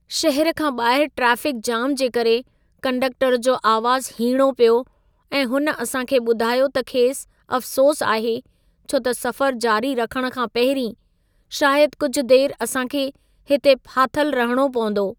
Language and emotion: Sindhi, sad